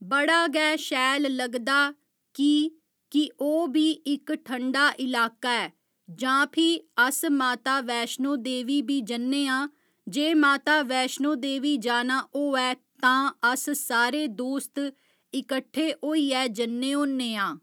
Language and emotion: Dogri, neutral